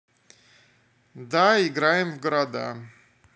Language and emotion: Russian, neutral